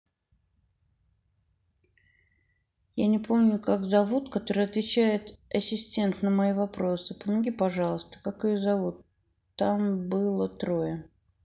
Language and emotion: Russian, neutral